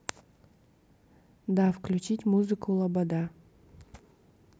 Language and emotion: Russian, neutral